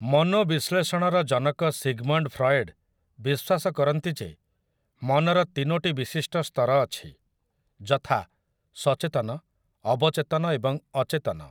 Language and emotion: Odia, neutral